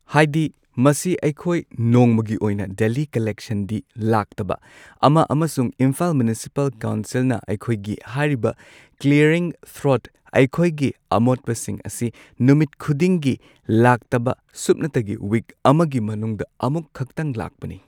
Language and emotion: Manipuri, neutral